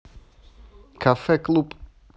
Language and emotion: Russian, neutral